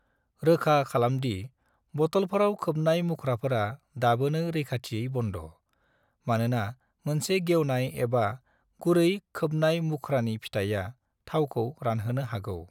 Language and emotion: Bodo, neutral